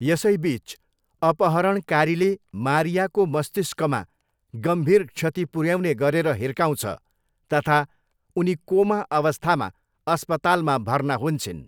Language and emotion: Nepali, neutral